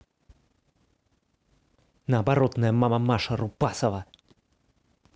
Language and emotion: Russian, angry